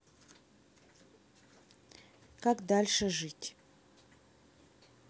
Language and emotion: Russian, neutral